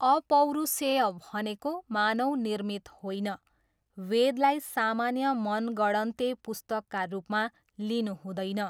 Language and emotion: Nepali, neutral